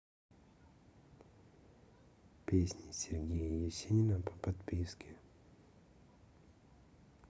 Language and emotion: Russian, neutral